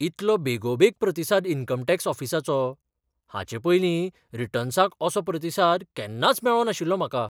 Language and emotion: Goan Konkani, surprised